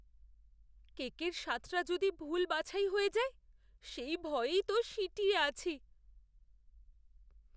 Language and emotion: Bengali, fearful